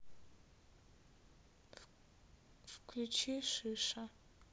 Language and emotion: Russian, neutral